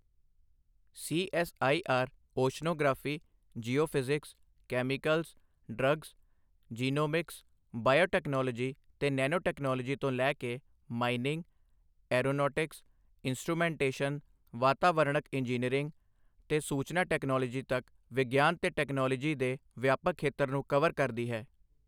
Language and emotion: Punjabi, neutral